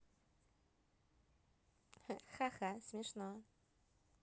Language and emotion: Russian, positive